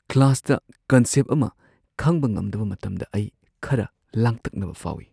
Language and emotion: Manipuri, fearful